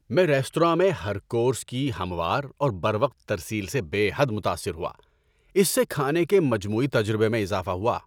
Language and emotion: Urdu, happy